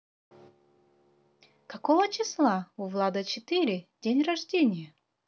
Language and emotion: Russian, positive